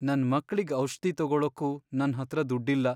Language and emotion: Kannada, sad